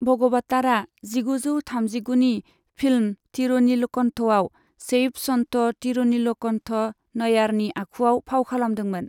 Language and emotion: Bodo, neutral